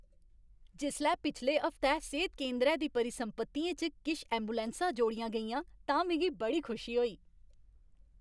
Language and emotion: Dogri, happy